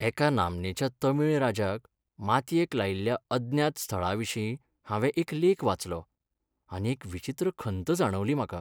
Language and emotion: Goan Konkani, sad